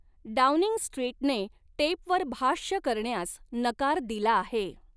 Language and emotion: Marathi, neutral